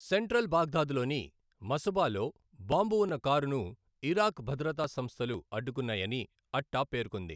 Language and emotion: Telugu, neutral